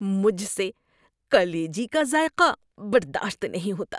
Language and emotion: Urdu, disgusted